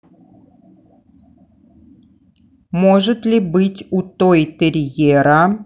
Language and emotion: Russian, neutral